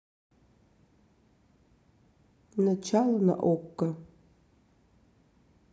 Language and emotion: Russian, neutral